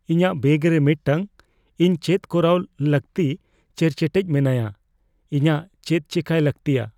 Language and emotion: Santali, fearful